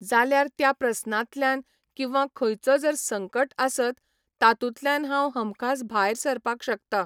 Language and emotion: Goan Konkani, neutral